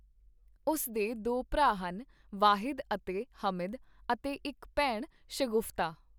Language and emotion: Punjabi, neutral